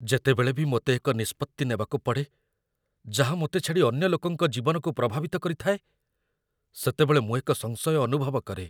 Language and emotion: Odia, fearful